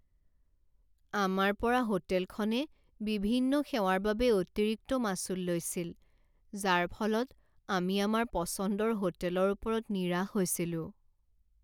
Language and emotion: Assamese, sad